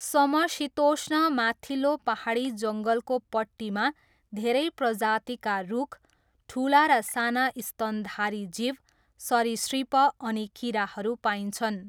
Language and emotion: Nepali, neutral